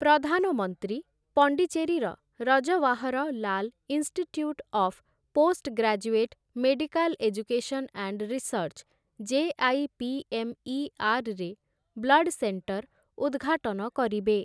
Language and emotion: Odia, neutral